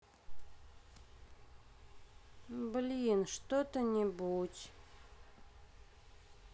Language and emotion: Russian, sad